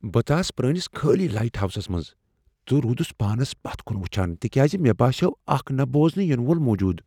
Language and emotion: Kashmiri, fearful